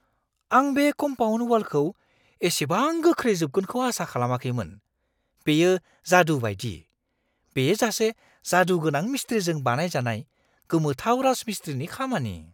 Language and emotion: Bodo, surprised